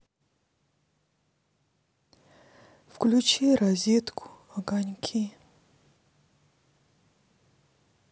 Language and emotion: Russian, sad